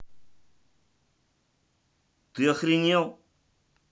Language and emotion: Russian, angry